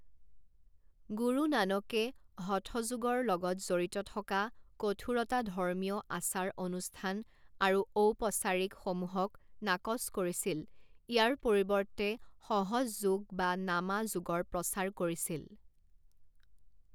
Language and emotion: Assamese, neutral